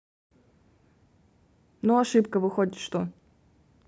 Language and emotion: Russian, neutral